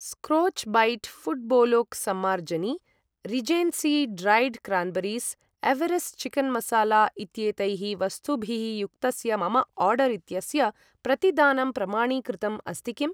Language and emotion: Sanskrit, neutral